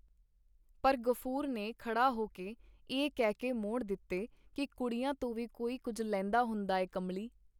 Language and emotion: Punjabi, neutral